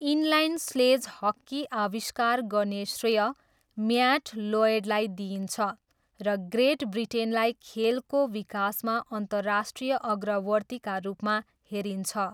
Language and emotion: Nepali, neutral